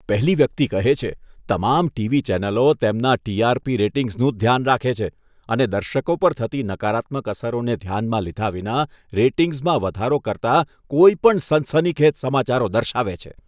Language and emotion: Gujarati, disgusted